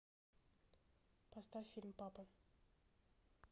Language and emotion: Russian, neutral